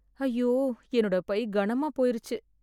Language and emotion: Tamil, sad